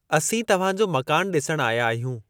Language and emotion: Sindhi, neutral